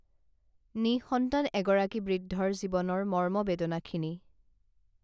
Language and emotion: Assamese, neutral